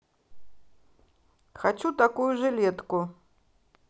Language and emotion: Russian, neutral